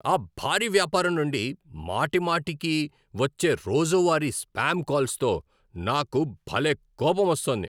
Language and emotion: Telugu, angry